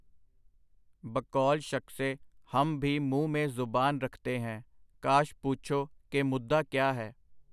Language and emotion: Punjabi, neutral